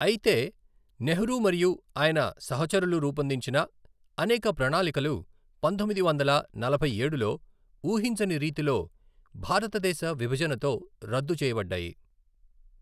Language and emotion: Telugu, neutral